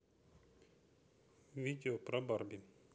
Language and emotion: Russian, neutral